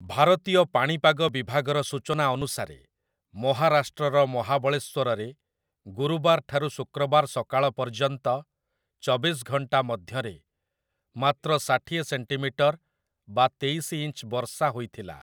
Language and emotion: Odia, neutral